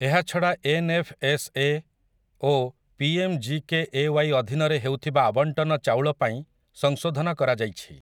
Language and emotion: Odia, neutral